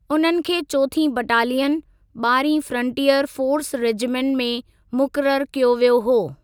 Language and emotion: Sindhi, neutral